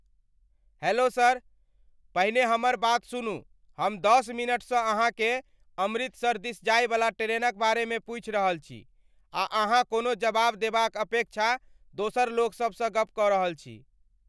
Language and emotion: Maithili, angry